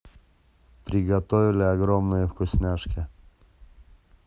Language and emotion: Russian, neutral